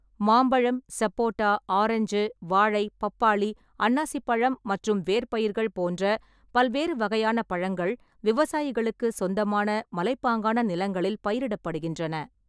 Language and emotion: Tamil, neutral